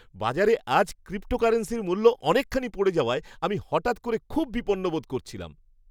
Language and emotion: Bengali, surprised